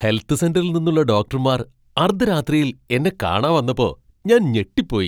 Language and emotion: Malayalam, surprised